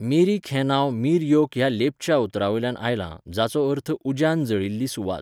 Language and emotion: Goan Konkani, neutral